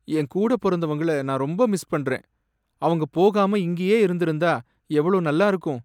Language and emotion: Tamil, sad